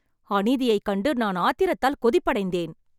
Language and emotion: Tamil, angry